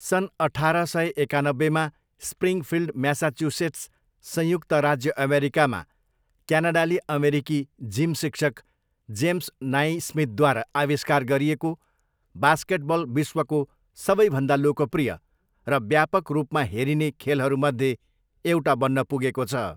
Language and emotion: Nepali, neutral